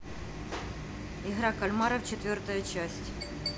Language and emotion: Russian, neutral